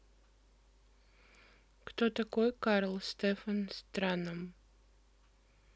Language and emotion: Russian, neutral